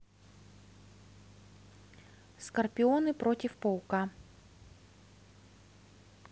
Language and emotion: Russian, neutral